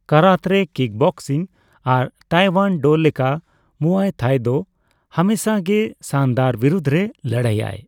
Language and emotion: Santali, neutral